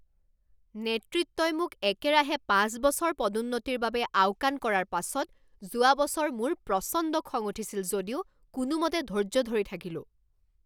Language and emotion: Assamese, angry